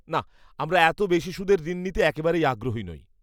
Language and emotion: Bengali, disgusted